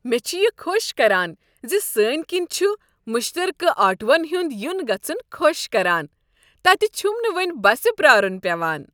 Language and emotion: Kashmiri, happy